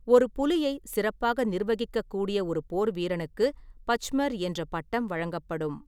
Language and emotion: Tamil, neutral